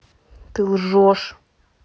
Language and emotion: Russian, angry